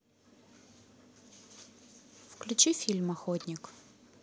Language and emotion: Russian, neutral